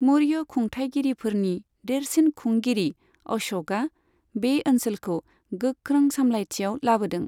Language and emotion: Bodo, neutral